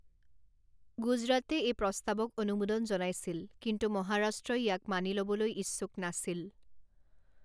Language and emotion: Assamese, neutral